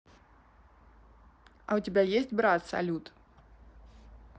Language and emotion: Russian, neutral